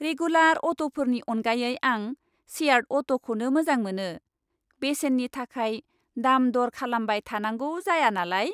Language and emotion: Bodo, happy